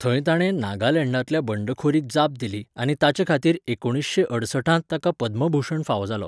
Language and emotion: Goan Konkani, neutral